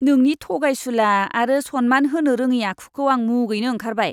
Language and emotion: Bodo, disgusted